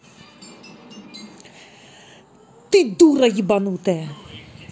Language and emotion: Russian, angry